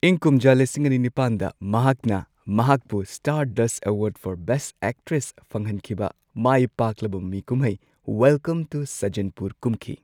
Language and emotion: Manipuri, neutral